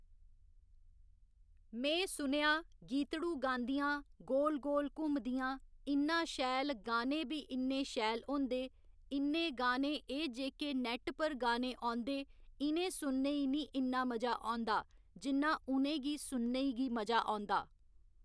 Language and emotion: Dogri, neutral